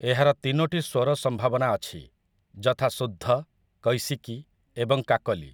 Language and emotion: Odia, neutral